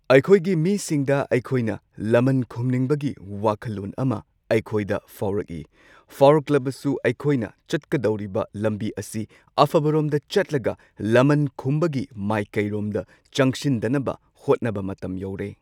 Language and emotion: Manipuri, neutral